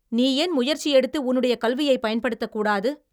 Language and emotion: Tamil, angry